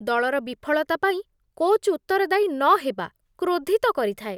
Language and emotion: Odia, disgusted